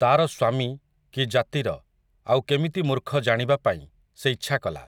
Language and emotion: Odia, neutral